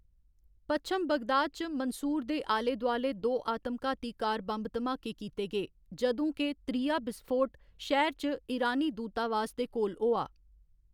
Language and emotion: Dogri, neutral